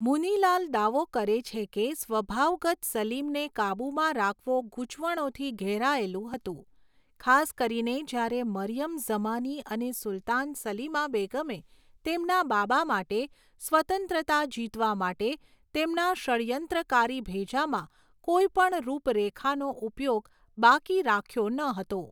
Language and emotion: Gujarati, neutral